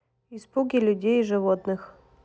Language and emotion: Russian, neutral